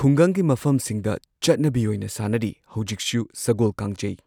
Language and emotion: Manipuri, neutral